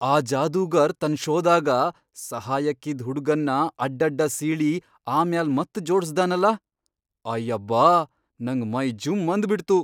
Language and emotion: Kannada, surprised